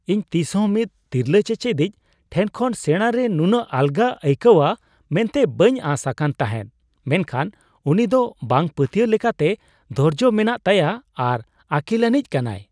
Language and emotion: Santali, surprised